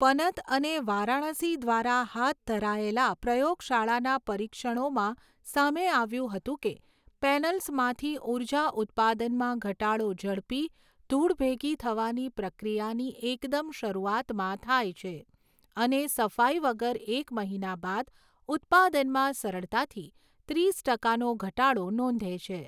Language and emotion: Gujarati, neutral